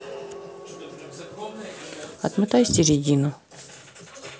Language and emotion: Russian, neutral